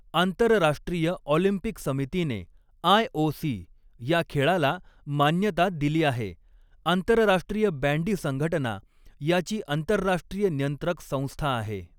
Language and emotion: Marathi, neutral